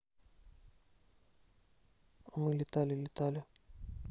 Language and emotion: Russian, neutral